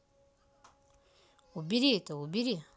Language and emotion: Russian, neutral